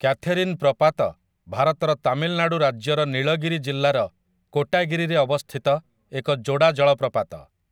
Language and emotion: Odia, neutral